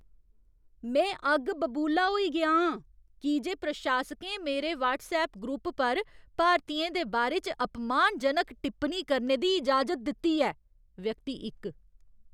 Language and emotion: Dogri, angry